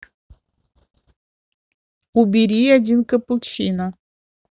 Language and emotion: Russian, neutral